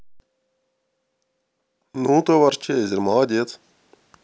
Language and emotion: Russian, positive